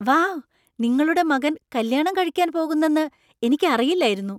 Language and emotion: Malayalam, surprised